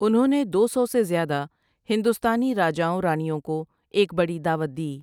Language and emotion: Urdu, neutral